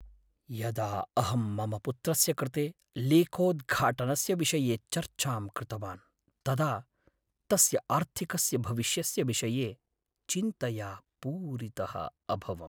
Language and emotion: Sanskrit, sad